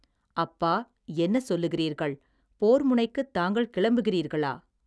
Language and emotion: Tamil, neutral